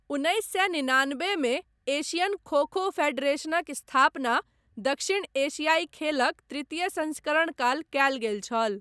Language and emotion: Maithili, neutral